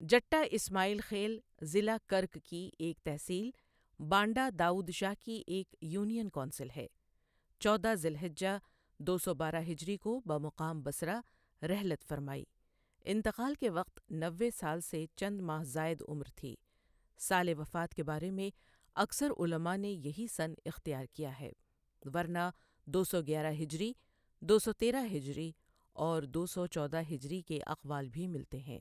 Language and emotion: Urdu, neutral